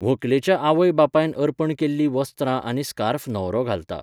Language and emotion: Goan Konkani, neutral